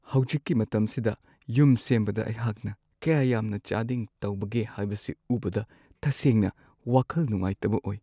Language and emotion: Manipuri, sad